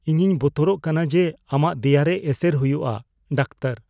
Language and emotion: Santali, fearful